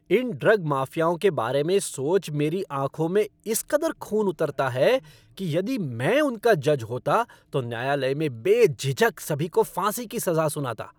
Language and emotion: Hindi, angry